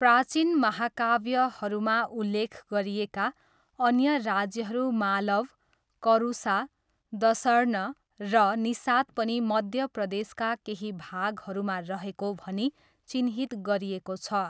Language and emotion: Nepali, neutral